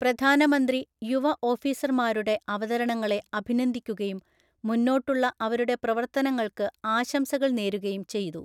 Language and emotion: Malayalam, neutral